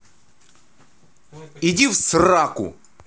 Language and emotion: Russian, angry